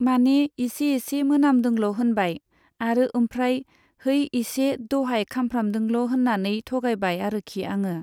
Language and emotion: Bodo, neutral